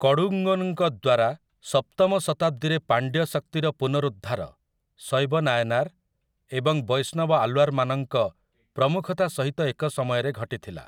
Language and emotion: Odia, neutral